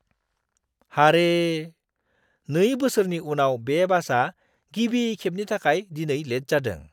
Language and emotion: Bodo, surprised